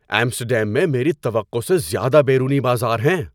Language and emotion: Urdu, surprised